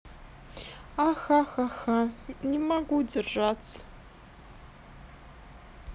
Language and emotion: Russian, sad